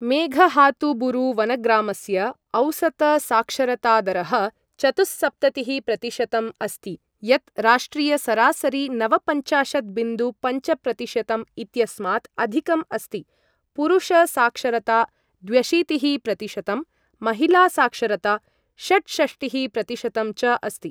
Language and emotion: Sanskrit, neutral